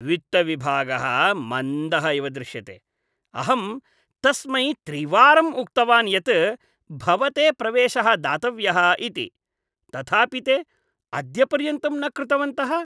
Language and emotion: Sanskrit, disgusted